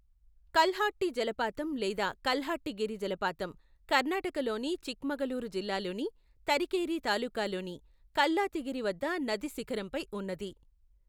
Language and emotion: Telugu, neutral